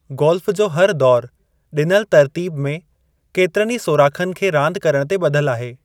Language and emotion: Sindhi, neutral